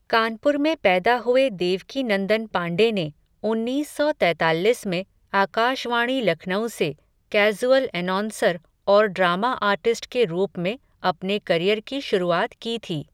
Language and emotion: Hindi, neutral